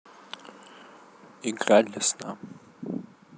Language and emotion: Russian, sad